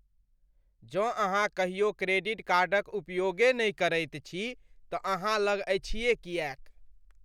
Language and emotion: Maithili, disgusted